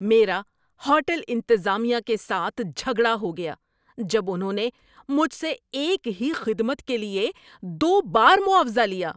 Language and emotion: Urdu, angry